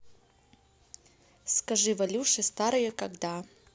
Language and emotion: Russian, neutral